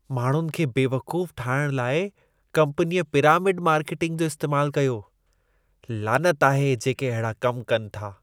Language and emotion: Sindhi, disgusted